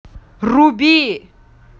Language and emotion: Russian, angry